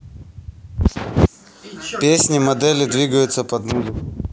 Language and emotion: Russian, neutral